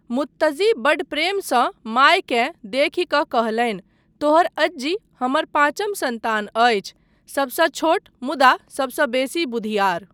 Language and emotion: Maithili, neutral